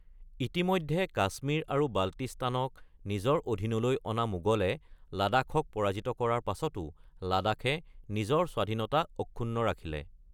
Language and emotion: Assamese, neutral